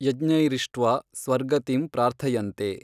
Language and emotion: Kannada, neutral